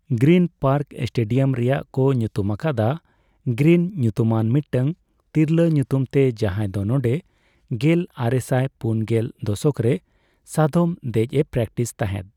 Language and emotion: Santali, neutral